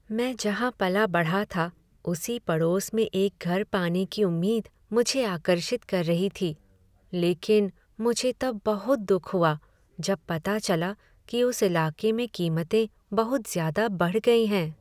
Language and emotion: Hindi, sad